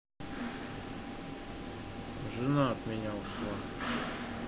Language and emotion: Russian, sad